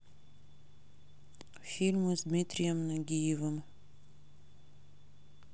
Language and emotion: Russian, neutral